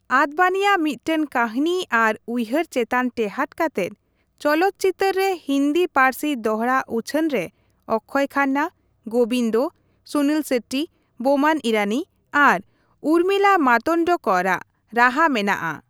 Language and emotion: Santali, neutral